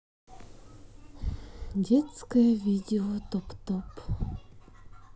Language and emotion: Russian, neutral